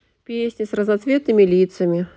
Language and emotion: Russian, neutral